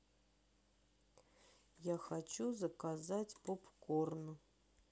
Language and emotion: Russian, sad